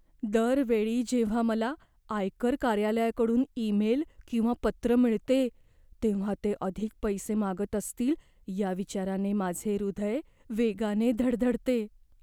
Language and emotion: Marathi, fearful